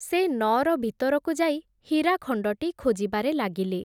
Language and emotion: Odia, neutral